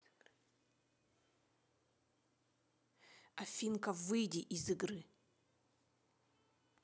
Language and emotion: Russian, angry